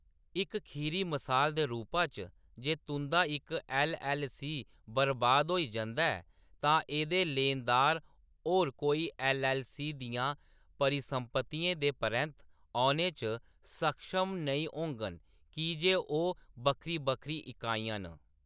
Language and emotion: Dogri, neutral